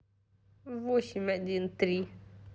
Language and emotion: Russian, neutral